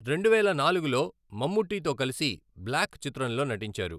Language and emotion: Telugu, neutral